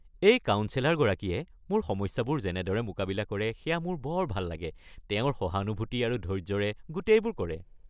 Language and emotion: Assamese, happy